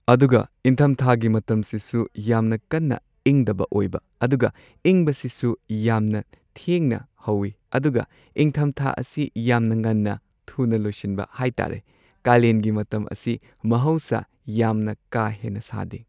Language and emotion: Manipuri, neutral